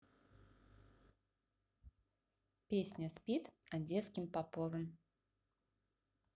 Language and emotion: Russian, neutral